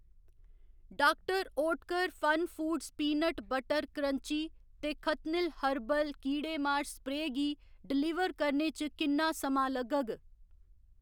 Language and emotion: Dogri, neutral